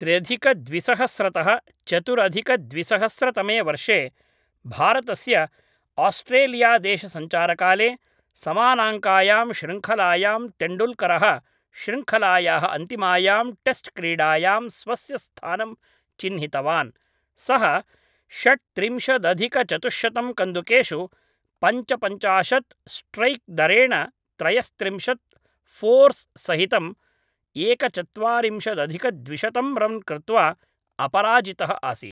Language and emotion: Sanskrit, neutral